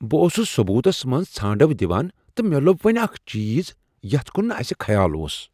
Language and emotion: Kashmiri, surprised